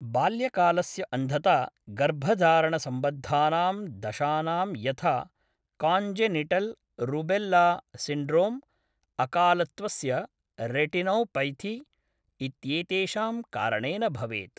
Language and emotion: Sanskrit, neutral